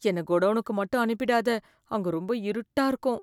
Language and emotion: Tamil, fearful